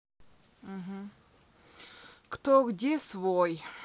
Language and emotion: Russian, sad